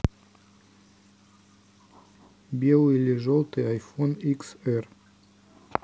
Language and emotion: Russian, neutral